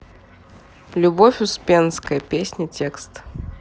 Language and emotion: Russian, neutral